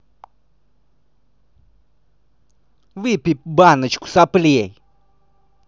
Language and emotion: Russian, angry